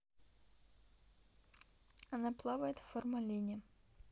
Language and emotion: Russian, neutral